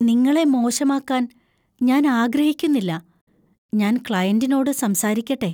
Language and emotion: Malayalam, fearful